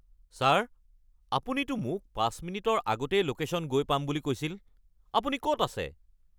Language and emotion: Assamese, angry